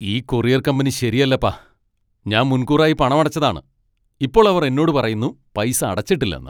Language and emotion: Malayalam, angry